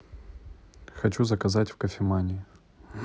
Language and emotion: Russian, neutral